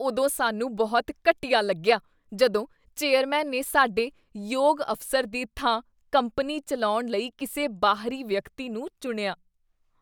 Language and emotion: Punjabi, disgusted